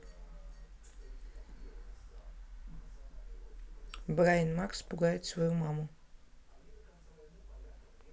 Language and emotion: Russian, neutral